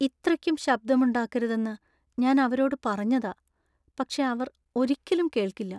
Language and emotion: Malayalam, sad